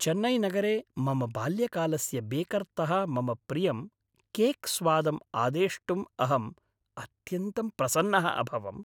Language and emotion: Sanskrit, happy